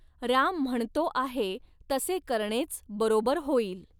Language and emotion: Marathi, neutral